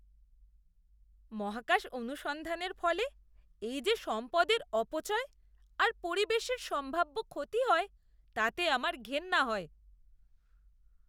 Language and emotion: Bengali, disgusted